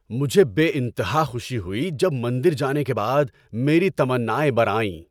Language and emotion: Urdu, happy